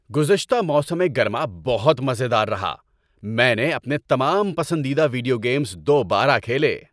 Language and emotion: Urdu, happy